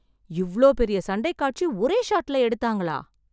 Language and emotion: Tamil, surprised